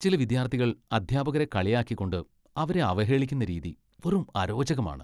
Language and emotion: Malayalam, disgusted